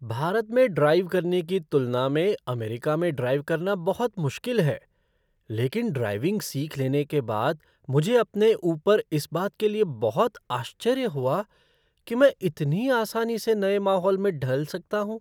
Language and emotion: Hindi, surprised